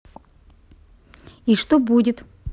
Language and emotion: Russian, neutral